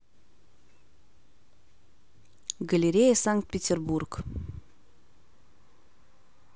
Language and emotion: Russian, neutral